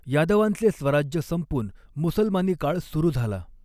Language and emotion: Marathi, neutral